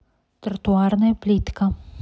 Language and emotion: Russian, neutral